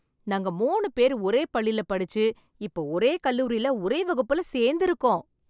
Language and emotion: Tamil, happy